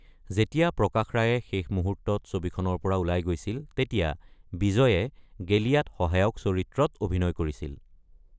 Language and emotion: Assamese, neutral